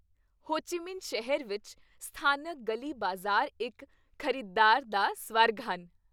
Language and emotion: Punjabi, happy